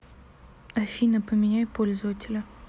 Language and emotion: Russian, sad